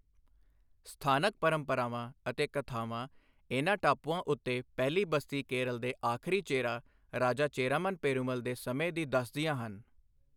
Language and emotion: Punjabi, neutral